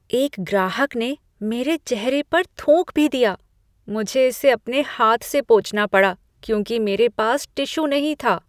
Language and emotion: Hindi, disgusted